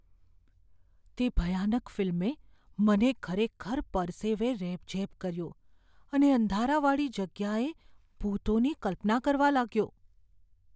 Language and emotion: Gujarati, fearful